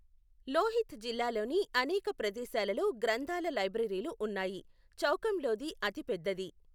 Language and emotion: Telugu, neutral